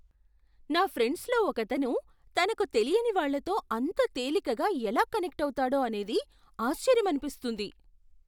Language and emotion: Telugu, surprised